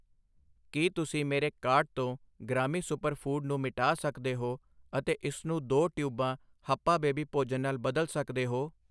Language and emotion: Punjabi, neutral